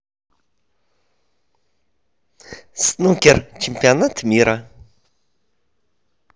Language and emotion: Russian, positive